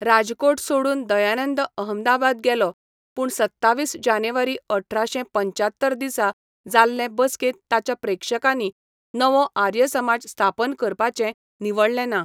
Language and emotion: Goan Konkani, neutral